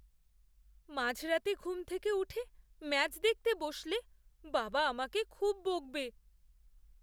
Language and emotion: Bengali, fearful